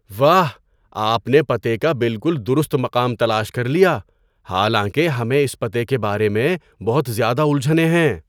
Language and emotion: Urdu, surprised